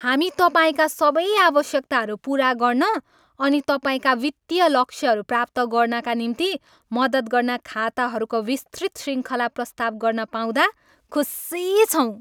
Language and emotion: Nepali, happy